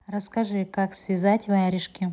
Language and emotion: Russian, neutral